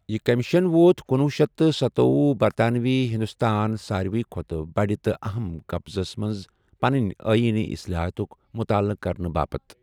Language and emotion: Kashmiri, neutral